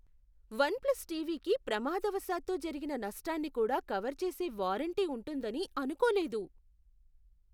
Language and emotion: Telugu, surprised